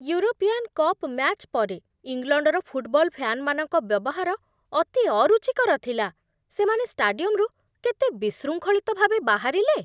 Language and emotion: Odia, disgusted